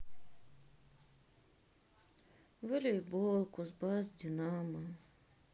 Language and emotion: Russian, sad